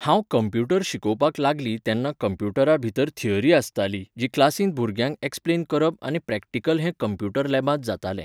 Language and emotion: Goan Konkani, neutral